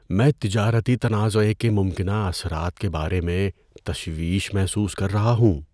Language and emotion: Urdu, fearful